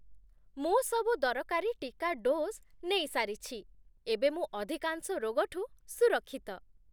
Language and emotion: Odia, happy